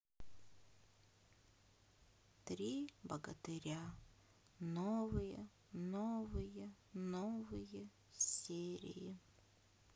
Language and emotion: Russian, sad